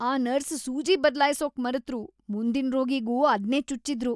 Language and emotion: Kannada, disgusted